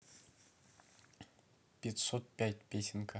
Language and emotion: Russian, neutral